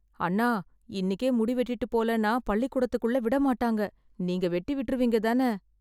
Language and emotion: Tamil, fearful